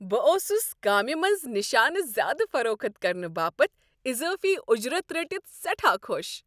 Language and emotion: Kashmiri, happy